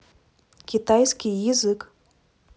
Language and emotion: Russian, neutral